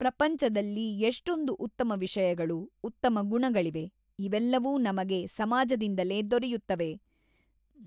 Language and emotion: Kannada, neutral